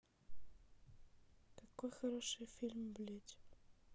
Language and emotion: Russian, sad